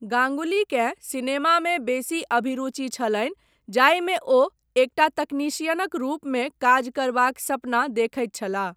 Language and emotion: Maithili, neutral